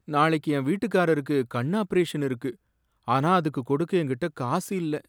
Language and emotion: Tamil, sad